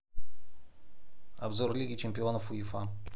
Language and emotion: Russian, neutral